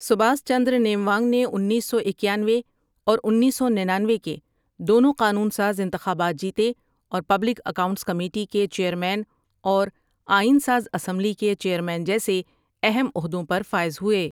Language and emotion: Urdu, neutral